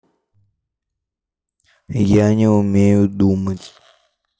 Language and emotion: Russian, neutral